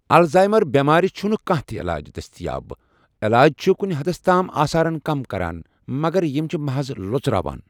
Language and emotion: Kashmiri, neutral